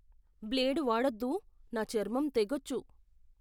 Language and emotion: Telugu, fearful